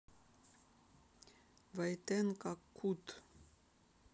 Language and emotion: Russian, neutral